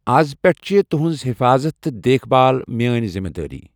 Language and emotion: Kashmiri, neutral